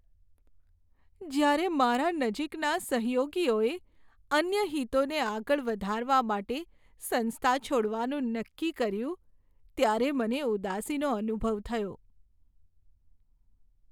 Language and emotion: Gujarati, sad